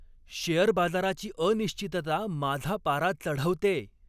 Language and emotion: Marathi, angry